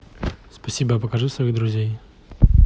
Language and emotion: Russian, neutral